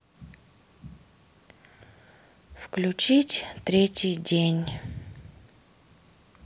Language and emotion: Russian, sad